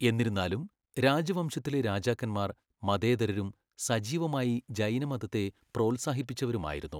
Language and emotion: Malayalam, neutral